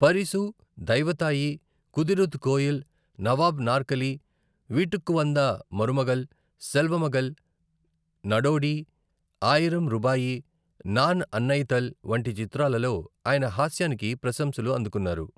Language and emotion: Telugu, neutral